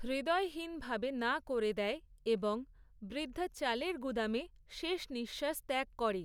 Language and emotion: Bengali, neutral